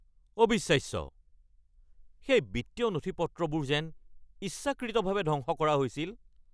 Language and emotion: Assamese, angry